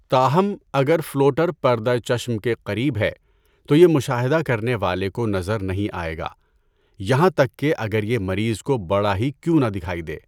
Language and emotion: Urdu, neutral